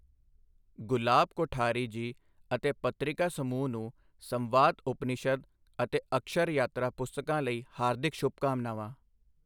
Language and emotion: Punjabi, neutral